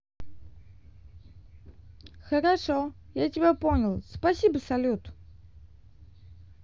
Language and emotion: Russian, positive